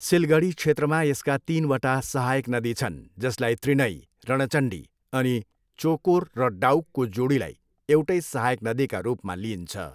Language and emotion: Nepali, neutral